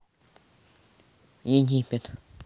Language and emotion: Russian, neutral